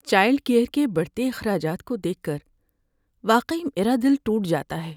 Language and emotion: Urdu, sad